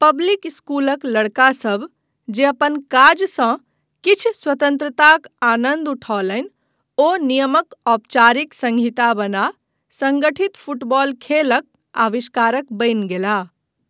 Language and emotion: Maithili, neutral